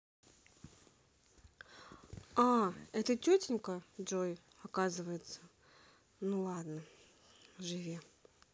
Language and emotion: Russian, neutral